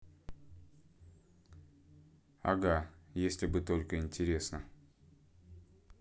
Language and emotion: Russian, neutral